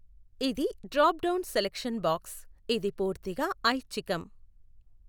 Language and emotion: Telugu, neutral